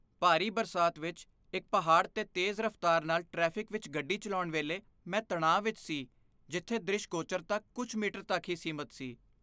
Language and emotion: Punjabi, fearful